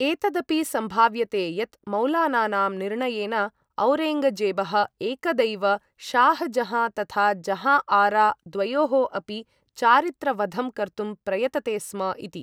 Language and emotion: Sanskrit, neutral